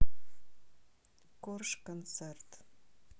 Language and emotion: Russian, neutral